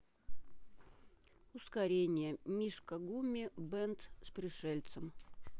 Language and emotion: Russian, neutral